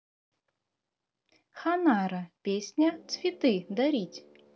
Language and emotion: Russian, positive